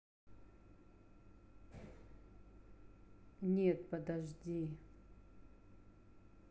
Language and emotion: Russian, neutral